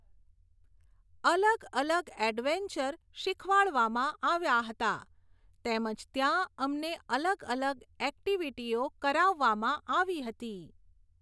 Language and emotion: Gujarati, neutral